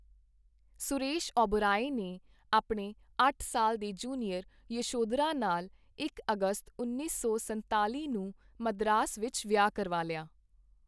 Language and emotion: Punjabi, neutral